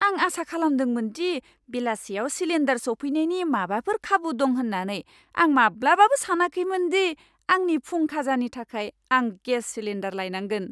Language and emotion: Bodo, surprised